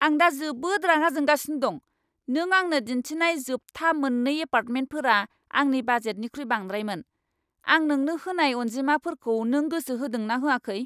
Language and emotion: Bodo, angry